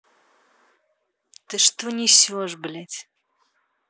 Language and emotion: Russian, angry